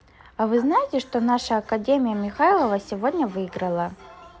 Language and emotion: Russian, neutral